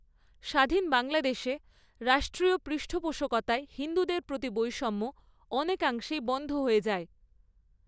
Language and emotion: Bengali, neutral